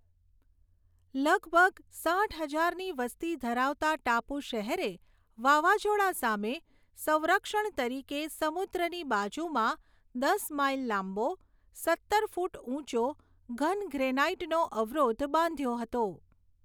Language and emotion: Gujarati, neutral